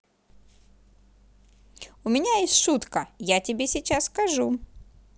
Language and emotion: Russian, positive